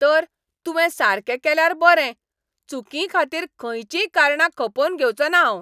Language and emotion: Goan Konkani, angry